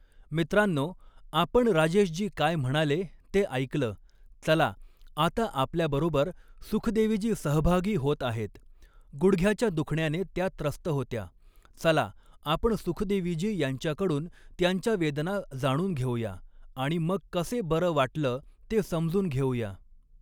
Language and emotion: Marathi, neutral